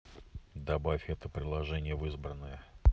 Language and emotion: Russian, neutral